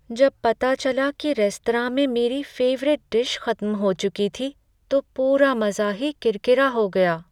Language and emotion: Hindi, sad